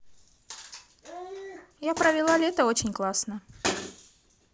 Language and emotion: Russian, positive